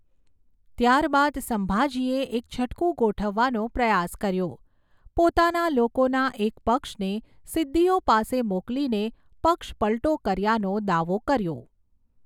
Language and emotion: Gujarati, neutral